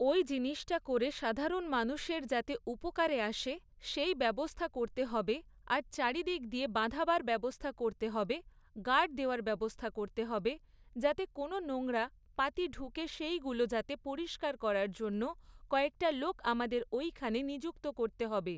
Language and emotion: Bengali, neutral